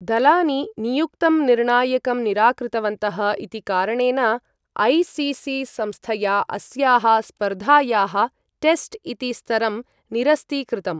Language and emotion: Sanskrit, neutral